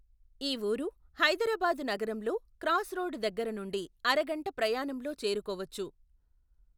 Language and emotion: Telugu, neutral